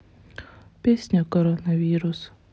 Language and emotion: Russian, sad